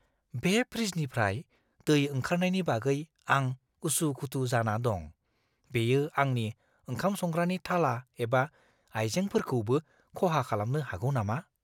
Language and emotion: Bodo, fearful